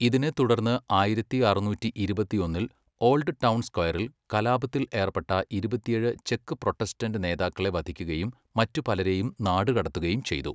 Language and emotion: Malayalam, neutral